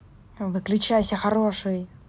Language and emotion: Russian, angry